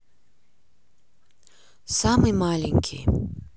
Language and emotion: Russian, neutral